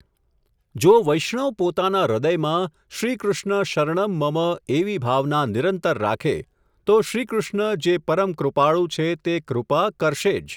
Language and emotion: Gujarati, neutral